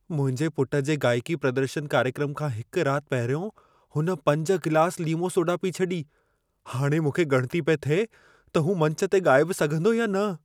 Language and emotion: Sindhi, fearful